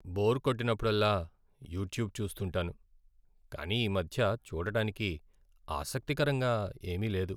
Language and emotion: Telugu, sad